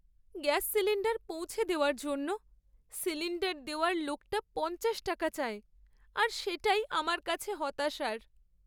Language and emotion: Bengali, sad